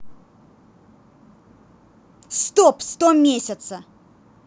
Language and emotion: Russian, angry